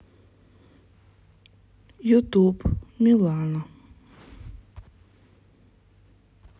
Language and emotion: Russian, sad